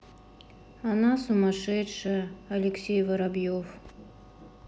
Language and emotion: Russian, sad